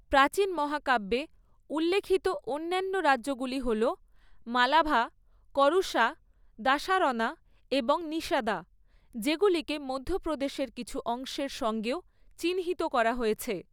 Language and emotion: Bengali, neutral